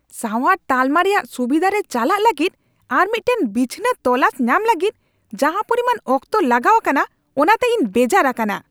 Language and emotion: Santali, angry